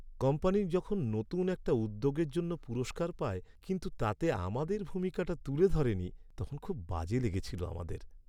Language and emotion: Bengali, sad